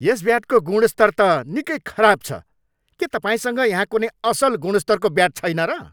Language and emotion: Nepali, angry